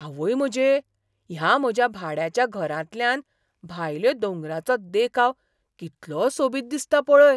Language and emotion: Goan Konkani, surprised